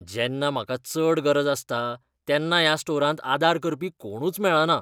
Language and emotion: Goan Konkani, disgusted